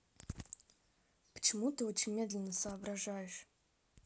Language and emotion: Russian, neutral